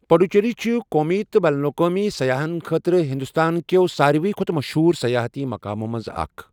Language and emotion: Kashmiri, neutral